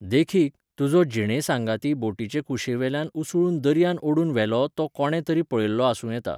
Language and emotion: Goan Konkani, neutral